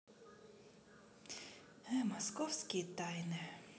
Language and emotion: Russian, sad